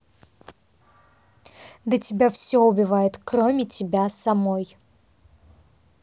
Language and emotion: Russian, angry